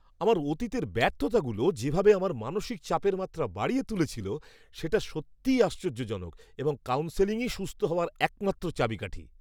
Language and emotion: Bengali, surprised